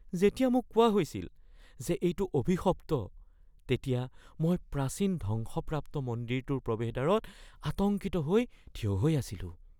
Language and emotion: Assamese, fearful